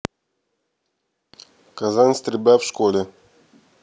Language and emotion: Russian, neutral